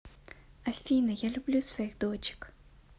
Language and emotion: Russian, positive